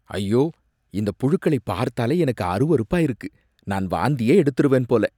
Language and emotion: Tamil, disgusted